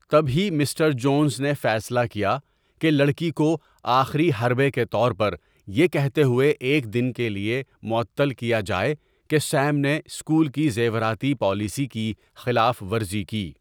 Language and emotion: Urdu, neutral